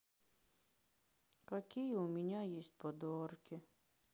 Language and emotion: Russian, sad